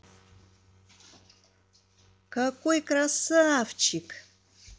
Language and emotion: Russian, positive